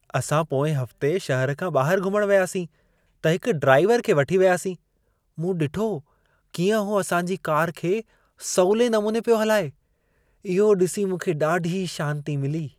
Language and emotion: Sindhi, happy